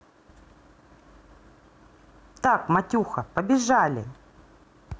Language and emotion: Russian, positive